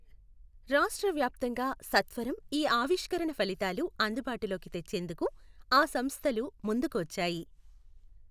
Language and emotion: Telugu, neutral